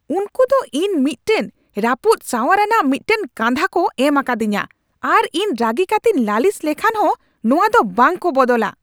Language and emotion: Santali, angry